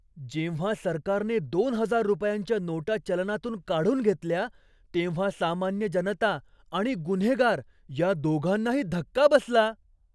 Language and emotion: Marathi, surprised